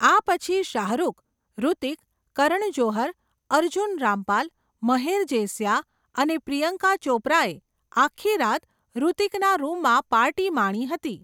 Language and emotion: Gujarati, neutral